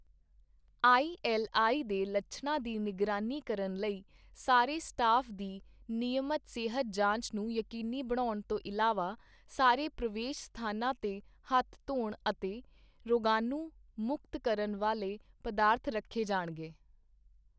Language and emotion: Punjabi, neutral